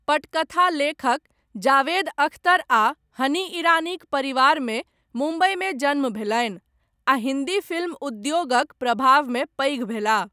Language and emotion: Maithili, neutral